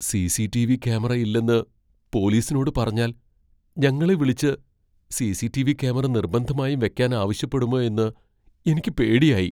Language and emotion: Malayalam, fearful